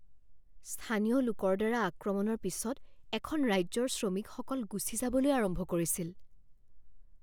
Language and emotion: Assamese, fearful